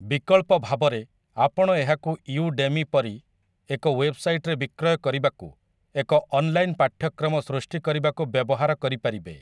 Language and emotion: Odia, neutral